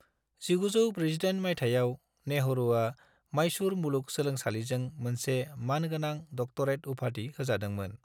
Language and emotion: Bodo, neutral